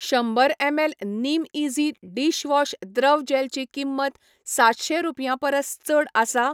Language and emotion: Goan Konkani, neutral